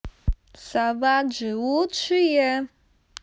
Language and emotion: Russian, positive